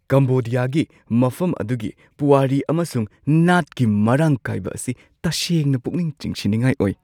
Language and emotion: Manipuri, surprised